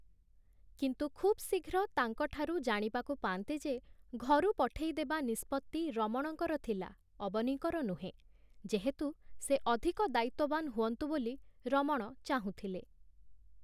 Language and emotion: Odia, neutral